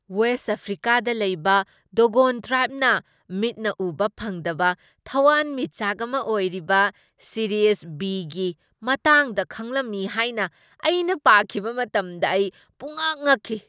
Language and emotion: Manipuri, surprised